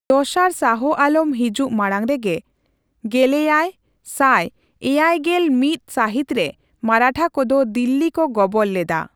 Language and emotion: Santali, neutral